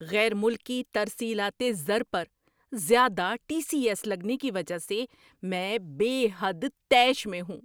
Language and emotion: Urdu, angry